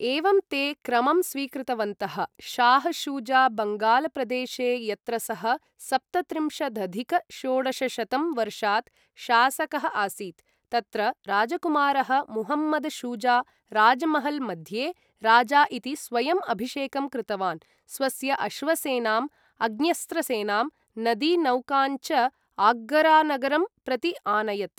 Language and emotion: Sanskrit, neutral